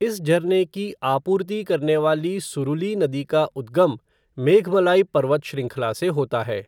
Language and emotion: Hindi, neutral